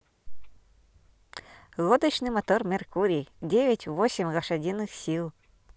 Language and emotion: Russian, positive